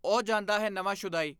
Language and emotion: Punjabi, neutral